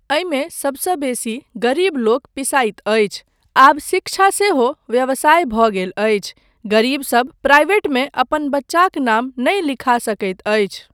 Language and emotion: Maithili, neutral